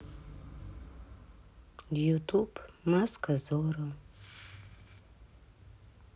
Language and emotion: Russian, sad